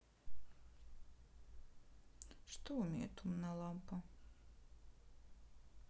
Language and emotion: Russian, sad